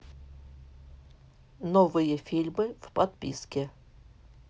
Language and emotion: Russian, neutral